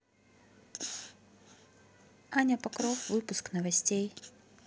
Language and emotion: Russian, neutral